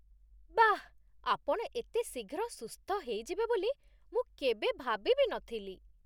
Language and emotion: Odia, surprised